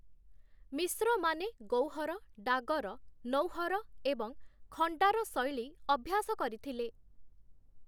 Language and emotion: Odia, neutral